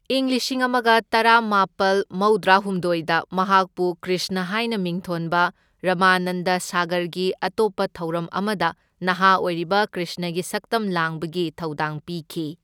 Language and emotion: Manipuri, neutral